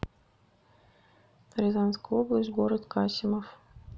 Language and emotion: Russian, neutral